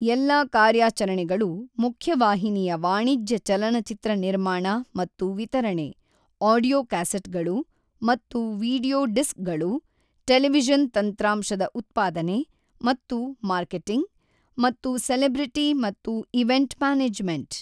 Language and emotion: Kannada, neutral